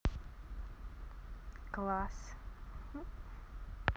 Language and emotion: Russian, positive